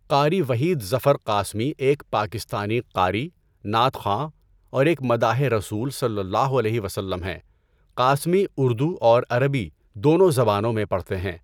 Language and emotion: Urdu, neutral